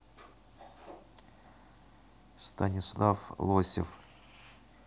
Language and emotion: Russian, neutral